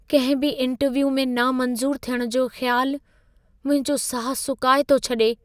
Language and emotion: Sindhi, fearful